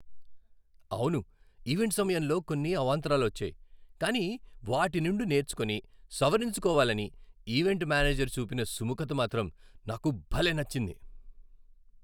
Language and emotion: Telugu, happy